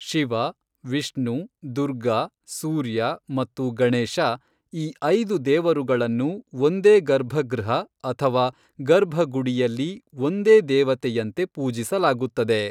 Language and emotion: Kannada, neutral